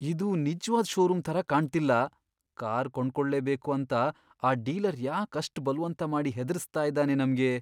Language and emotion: Kannada, fearful